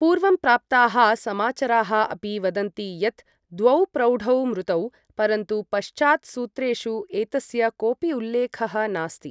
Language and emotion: Sanskrit, neutral